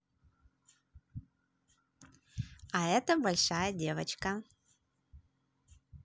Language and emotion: Russian, positive